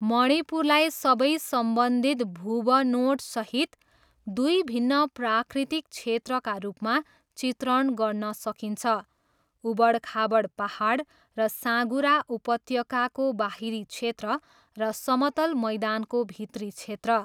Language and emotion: Nepali, neutral